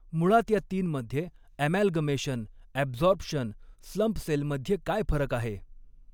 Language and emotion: Marathi, neutral